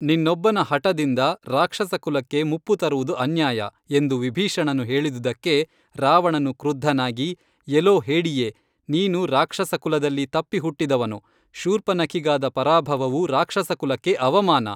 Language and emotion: Kannada, neutral